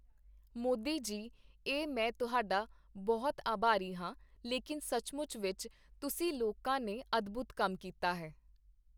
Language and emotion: Punjabi, neutral